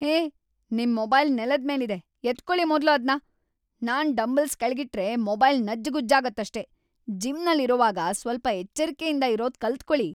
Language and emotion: Kannada, angry